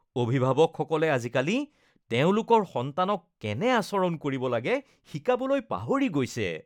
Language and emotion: Assamese, disgusted